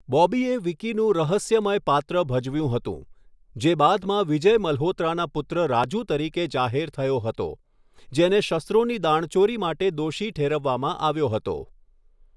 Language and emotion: Gujarati, neutral